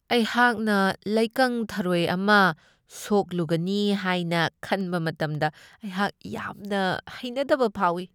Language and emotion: Manipuri, disgusted